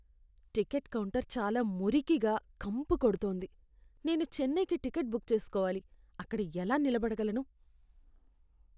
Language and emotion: Telugu, disgusted